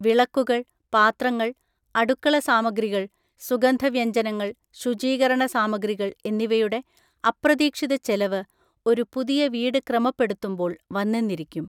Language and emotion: Malayalam, neutral